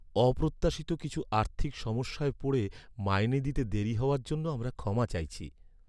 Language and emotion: Bengali, sad